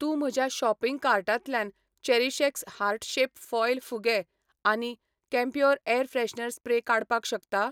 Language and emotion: Goan Konkani, neutral